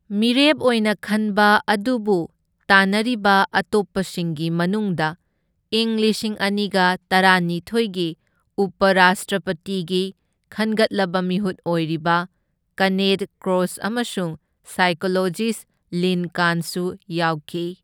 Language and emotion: Manipuri, neutral